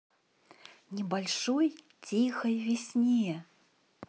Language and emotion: Russian, positive